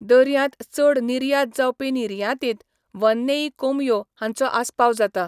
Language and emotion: Goan Konkani, neutral